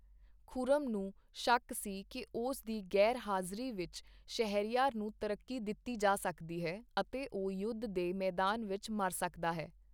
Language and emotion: Punjabi, neutral